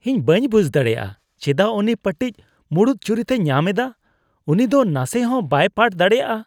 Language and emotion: Santali, disgusted